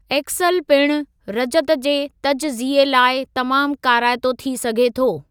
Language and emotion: Sindhi, neutral